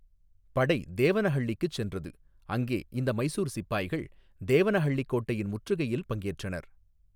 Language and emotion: Tamil, neutral